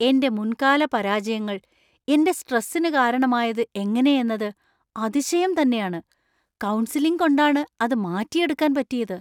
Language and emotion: Malayalam, surprised